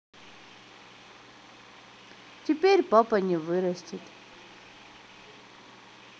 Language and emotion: Russian, sad